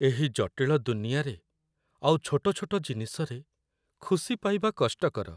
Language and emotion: Odia, sad